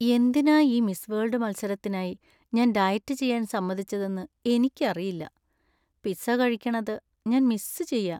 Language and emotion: Malayalam, sad